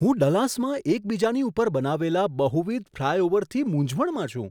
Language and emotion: Gujarati, surprised